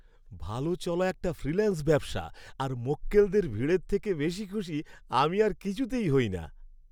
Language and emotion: Bengali, happy